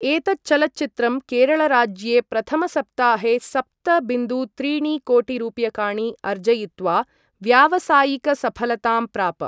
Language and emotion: Sanskrit, neutral